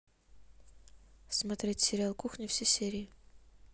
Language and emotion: Russian, neutral